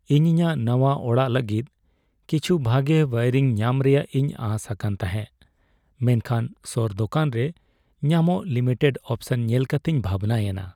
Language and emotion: Santali, sad